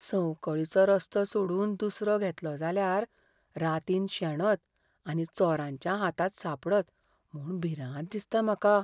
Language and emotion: Goan Konkani, fearful